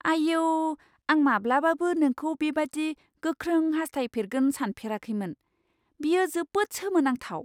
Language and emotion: Bodo, surprised